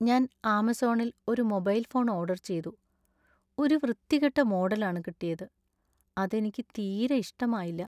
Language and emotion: Malayalam, sad